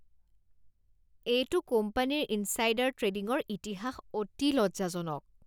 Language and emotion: Assamese, disgusted